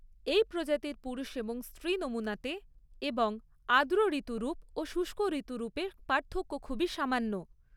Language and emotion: Bengali, neutral